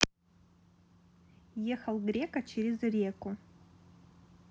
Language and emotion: Russian, neutral